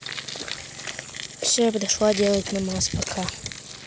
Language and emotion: Russian, neutral